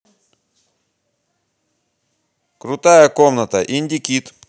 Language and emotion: Russian, positive